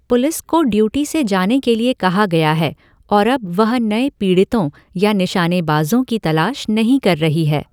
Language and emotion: Hindi, neutral